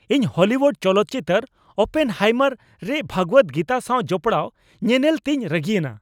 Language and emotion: Santali, angry